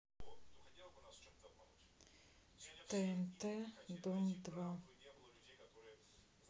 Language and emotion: Russian, sad